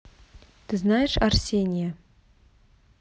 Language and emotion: Russian, neutral